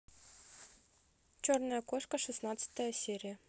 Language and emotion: Russian, neutral